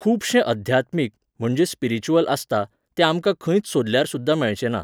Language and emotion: Goan Konkani, neutral